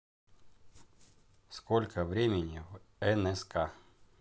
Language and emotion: Russian, neutral